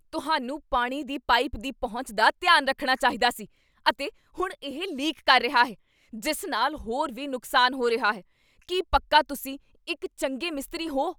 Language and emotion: Punjabi, angry